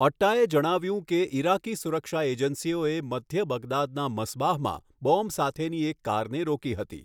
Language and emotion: Gujarati, neutral